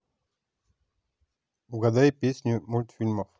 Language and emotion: Russian, neutral